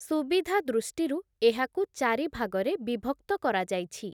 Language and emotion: Odia, neutral